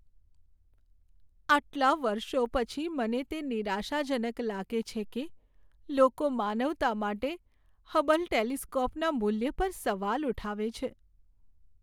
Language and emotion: Gujarati, sad